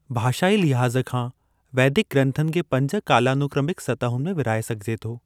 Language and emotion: Sindhi, neutral